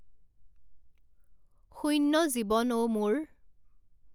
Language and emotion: Assamese, neutral